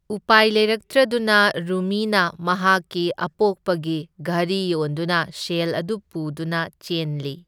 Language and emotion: Manipuri, neutral